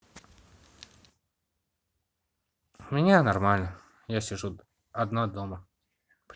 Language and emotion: Russian, neutral